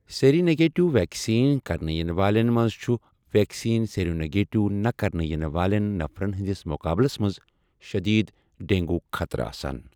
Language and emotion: Kashmiri, neutral